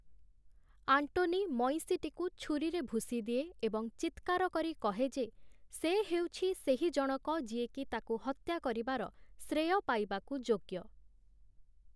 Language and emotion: Odia, neutral